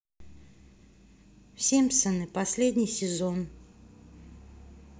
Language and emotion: Russian, neutral